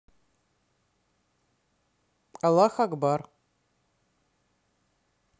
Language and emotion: Russian, neutral